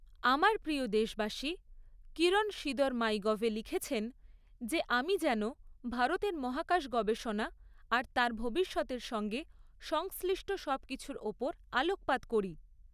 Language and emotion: Bengali, neutral